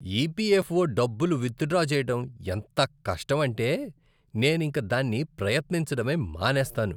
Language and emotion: Telugu, disgusted